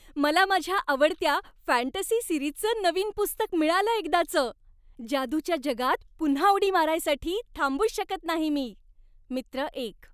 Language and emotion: Marathi, happy